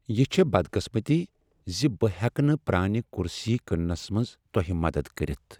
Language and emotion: Kashmiri, sad